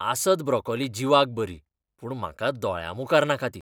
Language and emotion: Goan Konkani, disgusted